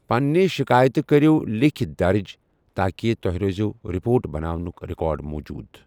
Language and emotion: Kashmiri, neutral